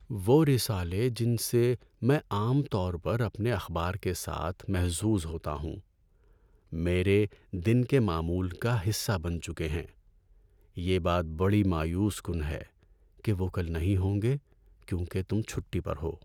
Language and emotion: Urdu, sad